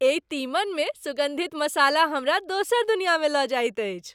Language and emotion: Maithili, happy